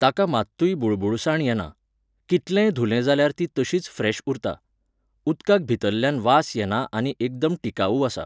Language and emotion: Goan Konkani, neutral